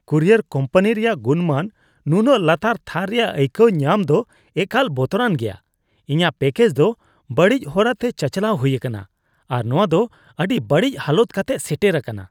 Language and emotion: Santali, disgusted